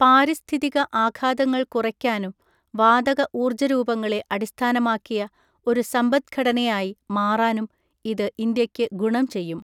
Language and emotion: Malayalam, neutral